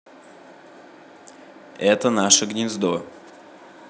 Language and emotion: Russian, neutral